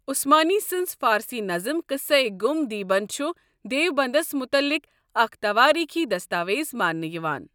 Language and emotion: Kashmiri, neutral